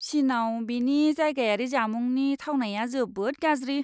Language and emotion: Bodo, disgusted